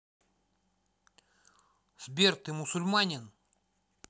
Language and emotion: Russian, angry